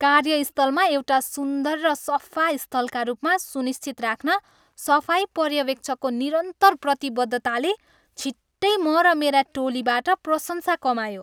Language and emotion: Nepali, happy